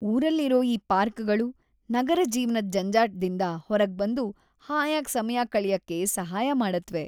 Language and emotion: Kannada, happy